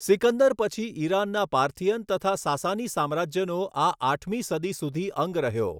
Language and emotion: Gujarati, neutral